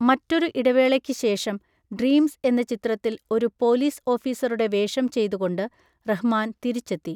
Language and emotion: Malayalam, neutral